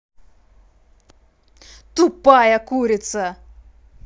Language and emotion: Russian, angry